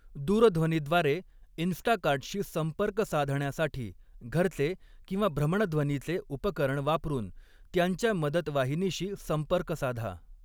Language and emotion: Marathi, neutral